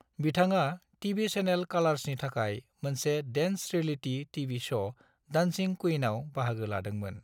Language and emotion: Bodo, neutral